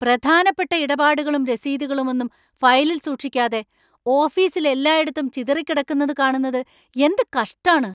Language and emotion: Malayalam, angry